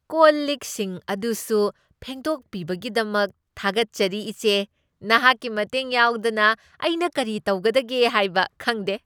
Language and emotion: Manipuri, happy